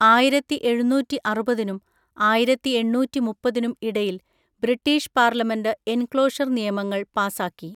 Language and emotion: Malayalam, neutral